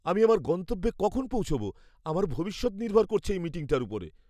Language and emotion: Bengali, fearful